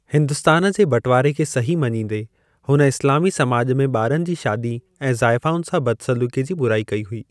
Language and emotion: Sindhi, neutral